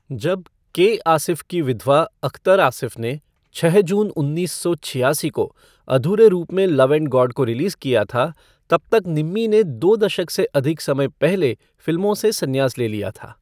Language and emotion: Hindi, neutral